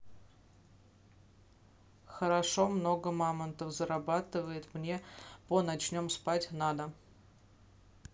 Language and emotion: Russian, neutral